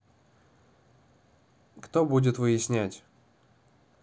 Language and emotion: Russian, neutral